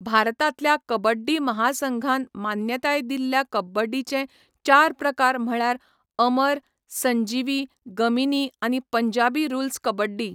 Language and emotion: Goan Konkani, neutral